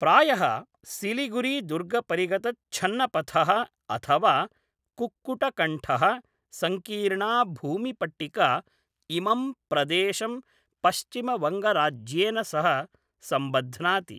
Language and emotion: Sanskrit, neutral